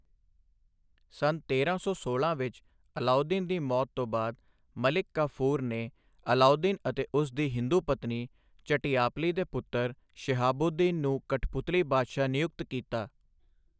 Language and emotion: Punjabi, neutral